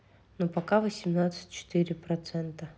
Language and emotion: Russian, neutral